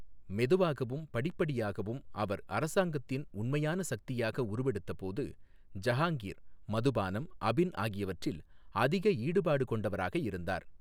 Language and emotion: Tamil, neutral